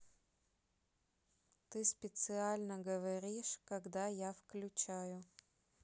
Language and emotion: Russian, neutral